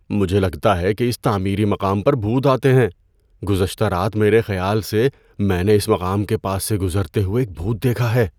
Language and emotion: Urdu, fearful